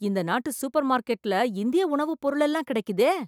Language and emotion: Tamil, surprised